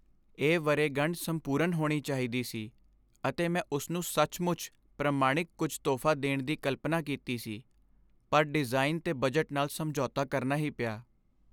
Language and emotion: Punjabi, sad